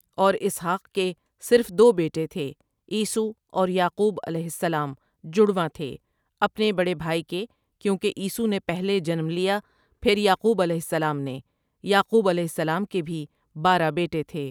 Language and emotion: Urdu, neutral